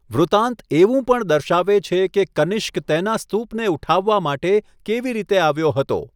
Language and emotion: Gujarati, neutral